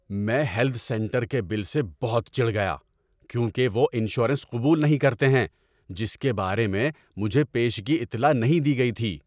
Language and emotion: Urdu, angry